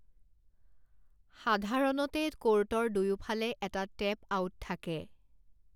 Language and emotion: Assamese, neutral